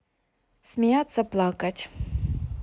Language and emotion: Russian, neutral